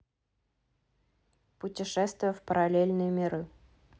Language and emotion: Russian, neutral